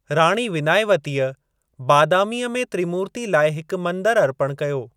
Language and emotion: Sindhi, neutral